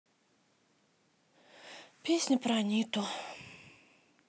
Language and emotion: Russian, sad